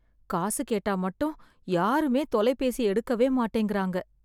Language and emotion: Tamil, sad